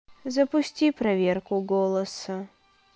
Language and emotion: Russian, sad